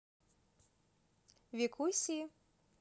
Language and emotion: Russian, positive